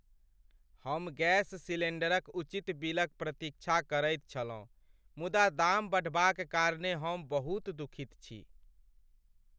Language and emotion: Maithili, sad